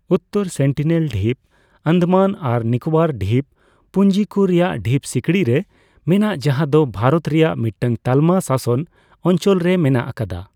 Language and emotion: Santali, neutral